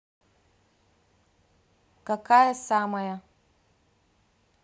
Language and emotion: Russian, neutral